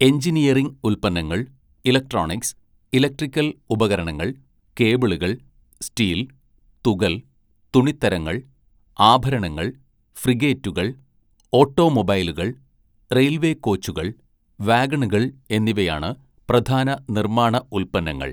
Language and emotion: Malayalam, neutral